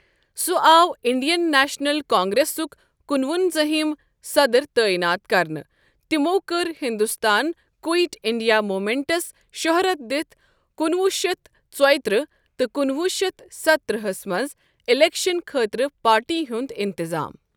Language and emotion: Kashmiri, neutral